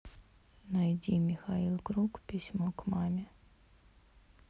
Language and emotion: Russian, neutral